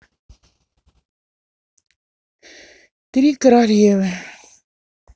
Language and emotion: Russian, sad